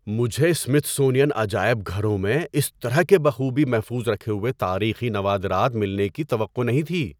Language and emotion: Urdu, surprised